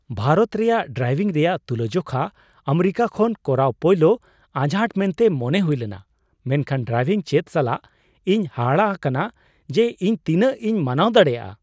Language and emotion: Santali, surprised